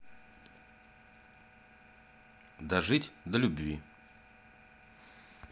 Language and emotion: Russian, neutral